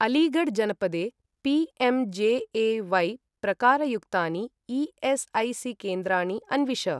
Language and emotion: Sanskrit, neutral